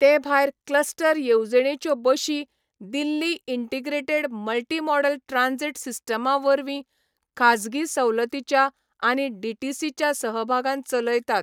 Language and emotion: Goan Konkani, neutral